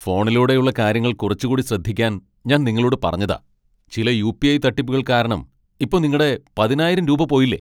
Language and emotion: Malayalam, angry